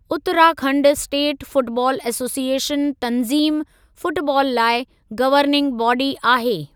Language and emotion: Sindhi, neutral